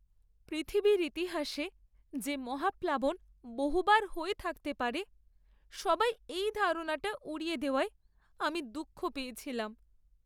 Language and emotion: Bengali, sad